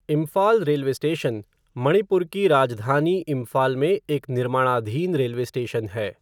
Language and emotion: Hindi, neutral